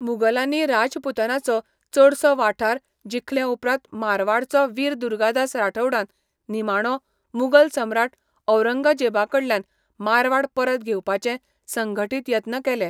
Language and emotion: Goan Konkani, neutral